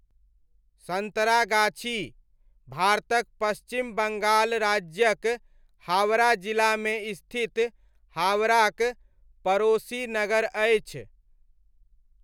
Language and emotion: Maithili, neutral